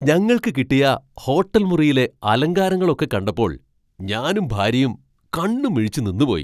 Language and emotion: Malayalam, surprised